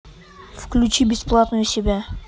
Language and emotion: Russian, neutral